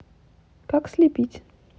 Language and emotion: Russian, neutral